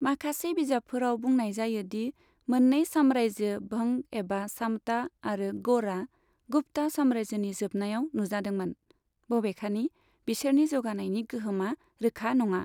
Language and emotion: Bodo, neutral